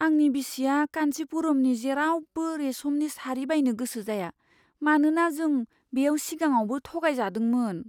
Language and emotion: Bodo, fearful